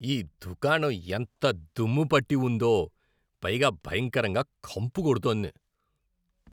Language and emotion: Telugu, disgusted